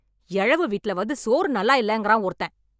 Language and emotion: Tamil, angry